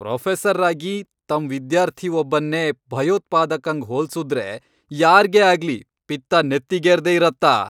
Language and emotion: Kannada, angry